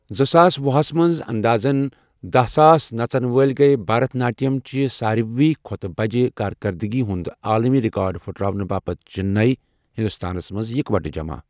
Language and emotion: Kashmiri, neutral